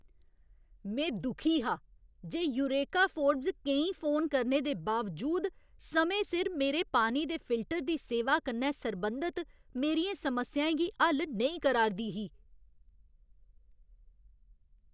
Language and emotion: Dogri, angry